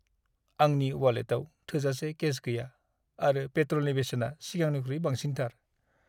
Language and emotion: Bodo, sad